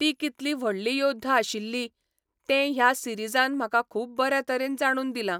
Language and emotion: Goan Konkani, neutral